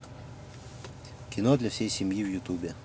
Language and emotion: Russian, neutral